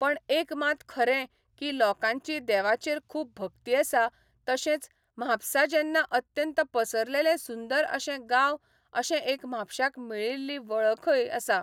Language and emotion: Goan Konkani, neutral